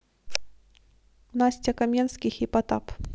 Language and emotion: Russian, neutral